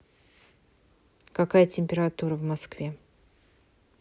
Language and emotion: Russian, neutral